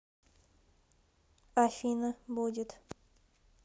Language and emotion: Russian, neutral